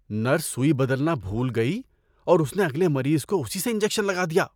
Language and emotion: Urdu, disgusted